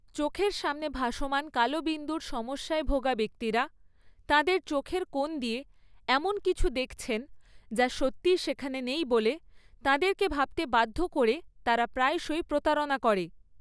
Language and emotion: Bengali, neutral